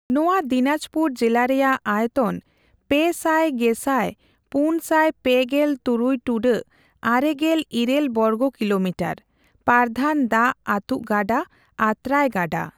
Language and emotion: Santali, neutral